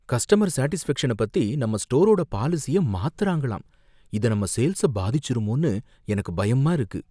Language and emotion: Tamil, fearful